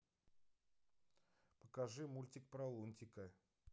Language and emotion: Russian, neutral